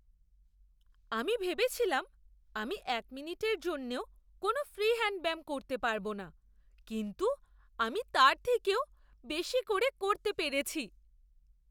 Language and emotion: Bengali, surprised